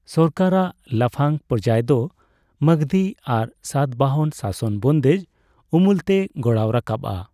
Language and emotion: Santali, neutral